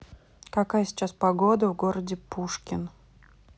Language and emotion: Russian, neutral